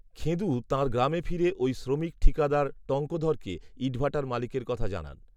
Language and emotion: Bengali, neutral